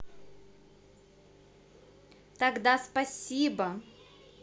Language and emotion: Russian, positive